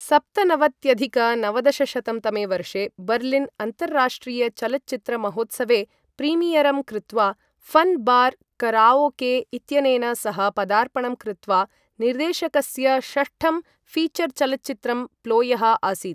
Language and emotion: Sanskrit, neutral